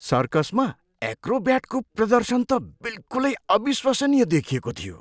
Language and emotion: Nepali, surprised